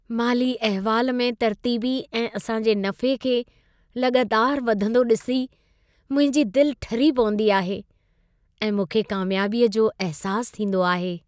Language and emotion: Sindhi, happy